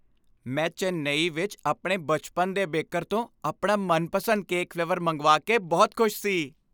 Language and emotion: Punjabi, happy